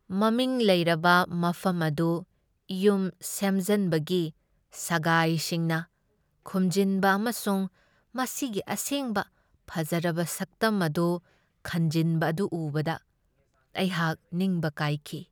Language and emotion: Manipuri, sad